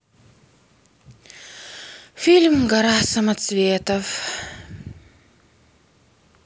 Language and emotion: Russian, sad